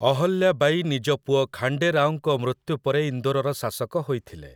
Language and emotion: Odia, neutral